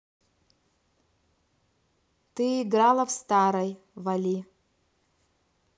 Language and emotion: Russian, neutral